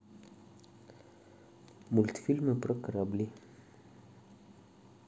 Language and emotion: Russian, neutral